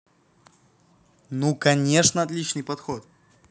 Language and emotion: Russian, positive